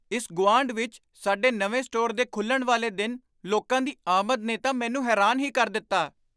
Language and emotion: Punjabi, surprised